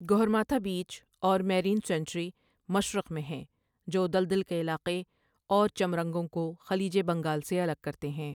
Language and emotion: Urdu, neutral